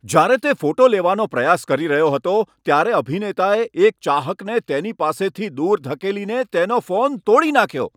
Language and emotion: Gujarati, angry